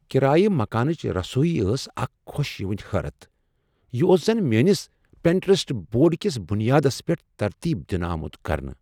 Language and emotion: Kashmiri, surprised